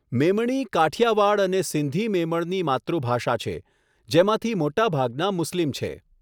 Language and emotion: Gujarati, neutral